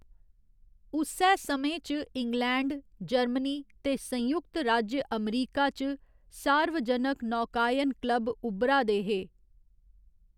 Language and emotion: Dogri, neutral